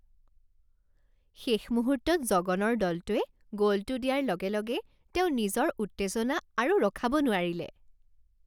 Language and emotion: Assamese, happy